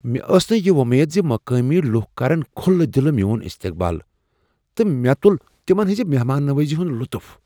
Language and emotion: Kashmiri, surprised